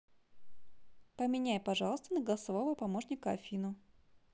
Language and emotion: Russian, neutral